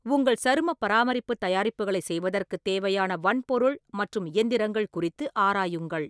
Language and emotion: Tamil, neutral